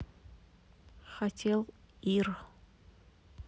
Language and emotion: Russian, neutral